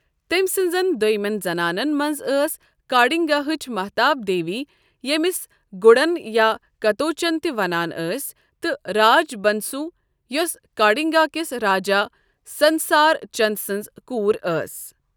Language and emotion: Kashmiri, neutral